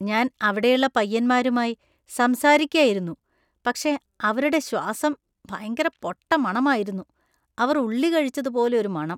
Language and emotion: Malayalam, disgusted